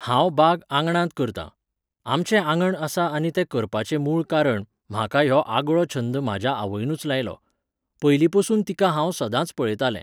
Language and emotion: Goan Konkani, neutral